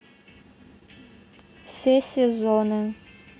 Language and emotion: Russian, neutral